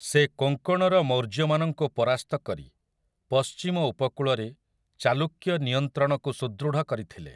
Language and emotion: Odia, neutral